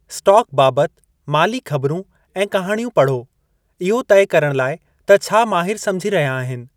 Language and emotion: Sindhi, neutral